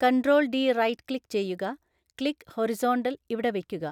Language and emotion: Malayalam, neutral